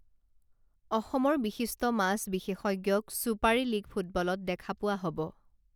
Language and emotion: Assamese, neutral